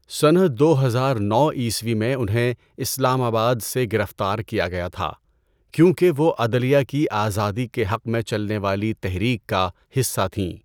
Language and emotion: Urdu, neutral